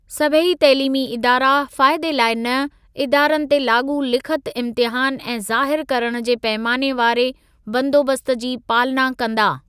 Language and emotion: Sindhi, neutral